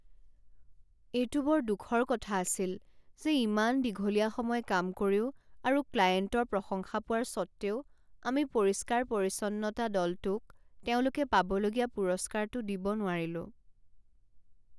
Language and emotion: Assamese, sad